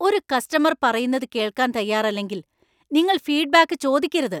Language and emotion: Malayalam, angry